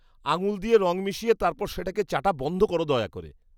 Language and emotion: Bengali, disgusted